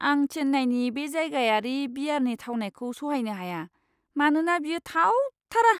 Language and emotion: Bodo, disgusted